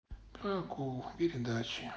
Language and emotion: Russian, sad